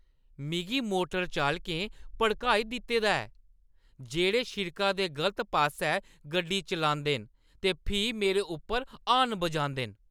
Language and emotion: Dogri, angry